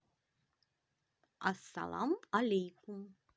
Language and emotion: Russian, positive